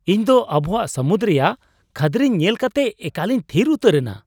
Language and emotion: Santali, surprised